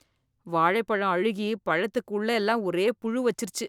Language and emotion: Tamil, disgusted